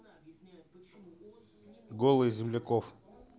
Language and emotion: Russian, neutral